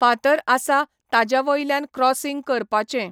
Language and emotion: Goan Konkani, neutral